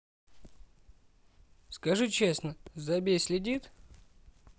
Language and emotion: Russian, neutral